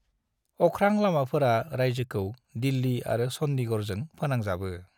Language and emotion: Bodo, neutral